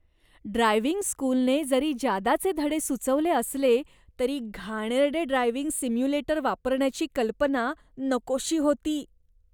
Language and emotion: Marathi, disgusted